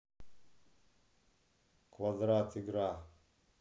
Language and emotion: Russian, neutral